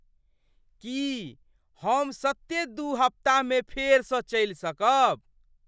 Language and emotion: Maithili, surprised